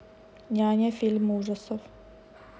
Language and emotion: Russian, neutral